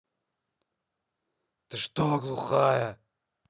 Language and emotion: Russian, angry